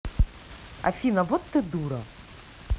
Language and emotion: Russian, angry